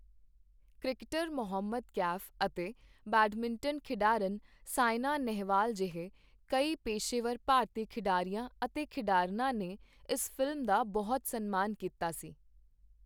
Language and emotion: Punjabi, neutral